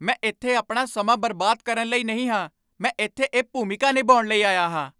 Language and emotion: Punjabi, angry